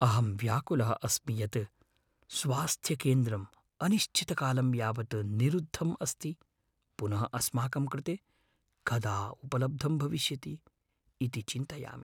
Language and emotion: Sanskrit, fearful